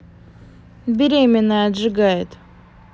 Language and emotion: Russian, neutral